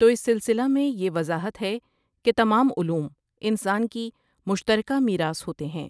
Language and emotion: Urdu, neutral